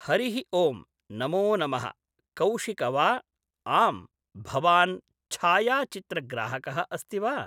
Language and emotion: Sanskrit, neutral